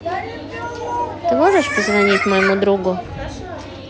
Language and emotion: Russian, neutral